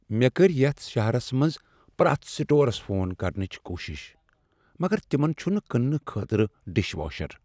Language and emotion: Kashmiri, sad